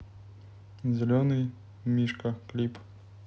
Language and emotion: Russian, neutral